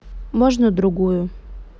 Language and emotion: Russian, neutral